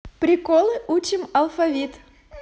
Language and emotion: Russian, positive